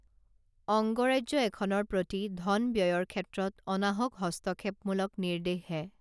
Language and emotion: Assamese, neutral